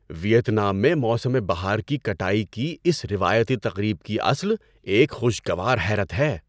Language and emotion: Urdu, surprised